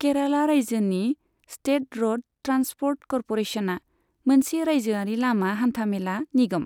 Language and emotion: Bodo, neutral